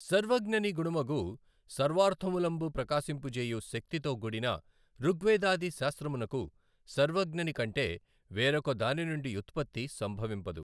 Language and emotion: Telugu, neutral